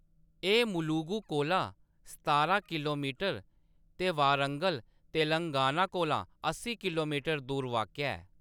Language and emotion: Dogri, neutral